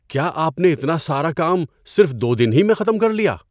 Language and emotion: Urdu, surprised